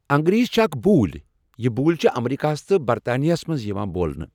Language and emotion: Kashmiri, neutral